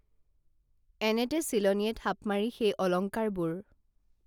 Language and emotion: Assamese, neutral